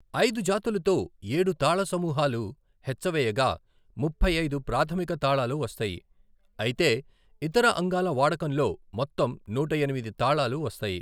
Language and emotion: Telugu, neutral